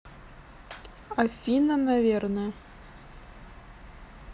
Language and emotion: Russian, neutral